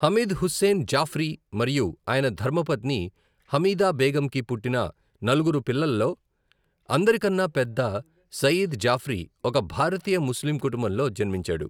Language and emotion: Telugu, neutral